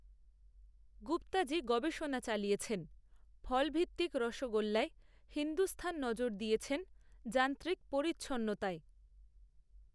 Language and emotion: Bengali, neutral